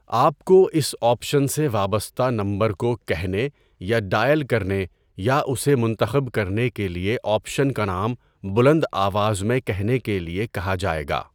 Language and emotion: Urdu, neutral